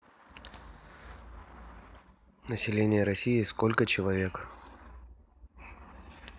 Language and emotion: Russian, neutral